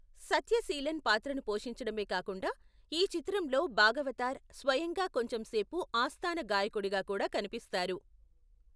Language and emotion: Telugu, neutral